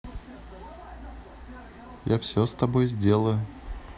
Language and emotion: Russian, neutral